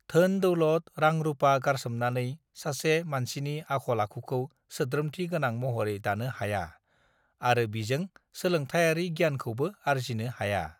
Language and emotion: Bodo, neutral